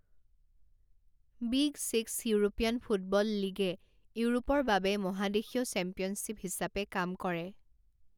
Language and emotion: Assamese, neutral